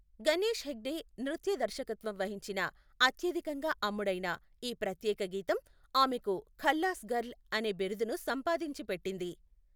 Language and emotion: Telugu, neutral